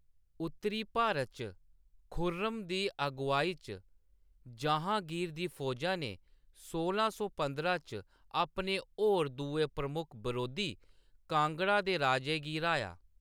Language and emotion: Dogri, neutral